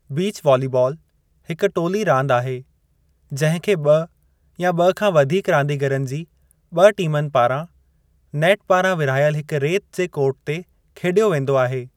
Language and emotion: Sindhi, neutral